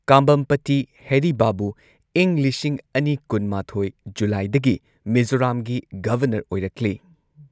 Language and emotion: Manipuri, neutral